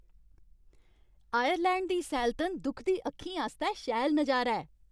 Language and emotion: Dogri, happy